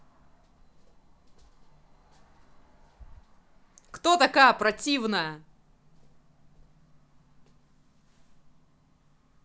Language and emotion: Russian, angry